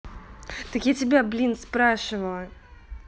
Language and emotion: Russian, angry